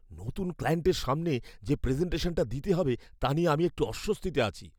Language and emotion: Bengali, fearful